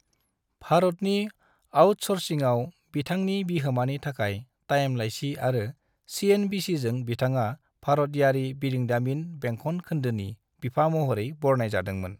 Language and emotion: Bodo, neutral